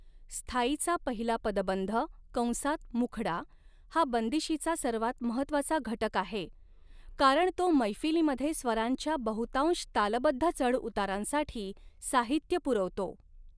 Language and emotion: Marathi, neutral